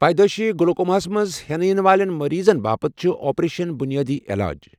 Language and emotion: Kashmiri, neutral